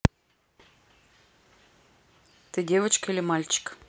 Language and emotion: Russian, neutral